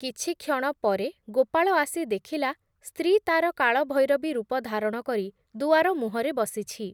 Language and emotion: Odia, neutral